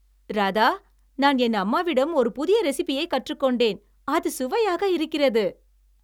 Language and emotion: Tamil, happy